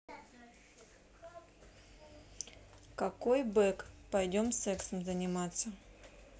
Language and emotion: Russian, neutral